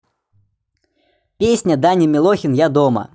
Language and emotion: Russian, neutral